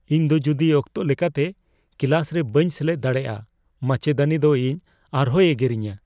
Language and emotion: Santali, fearful